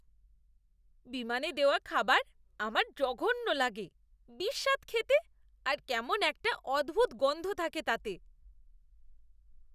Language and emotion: Bengali, disgusted